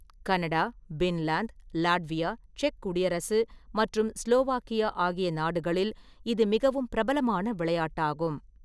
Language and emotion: Tamil, neutral